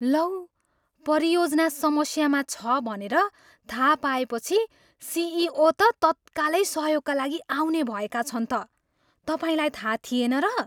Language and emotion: Nepali, surprised